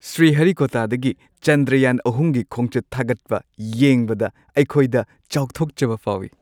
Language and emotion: Manipuri, happy